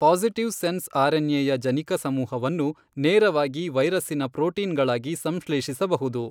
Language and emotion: Kannada, neutral